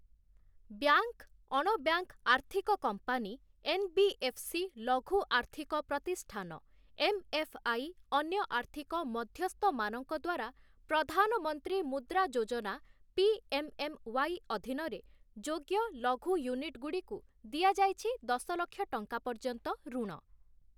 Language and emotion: Odia, neutral